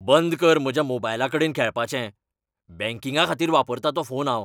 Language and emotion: Goan Konkani, angry